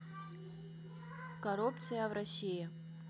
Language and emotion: Russian, neutral